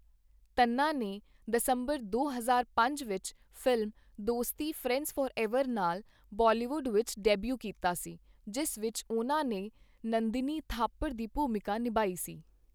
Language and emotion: Punjabi, neutral